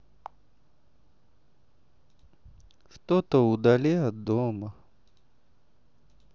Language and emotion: Russian, sad